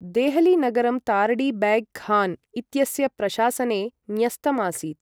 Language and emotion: Sanskrit, neutral